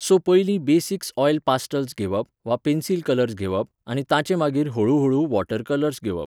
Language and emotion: Goan Konkani, neutral